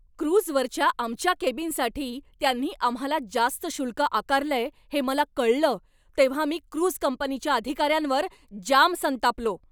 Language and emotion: Marathi, angry